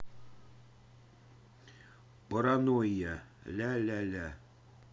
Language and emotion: Russian, neutral